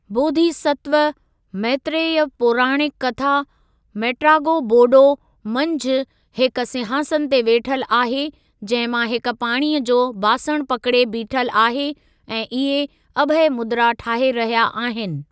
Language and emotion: Sindhi, neutral